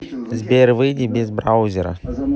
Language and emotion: Russian, neutral